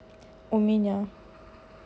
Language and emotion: Russian, neutral